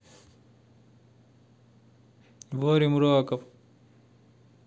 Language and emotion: Russian, neutral